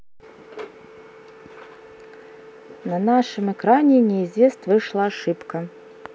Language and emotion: Russian, neutral